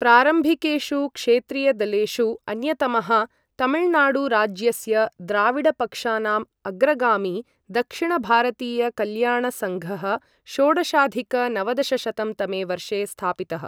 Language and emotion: Sanskrit, neutral